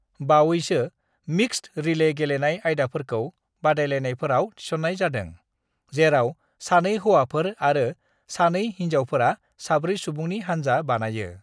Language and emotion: Bodo, neutral